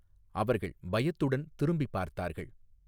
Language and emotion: Tamil, neutral